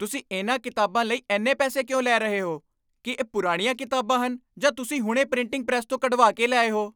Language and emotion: Punjabi, angry